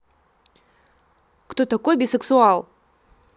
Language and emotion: Russian, angry